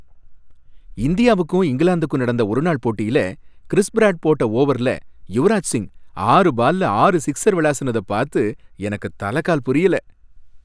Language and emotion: Tamil, happy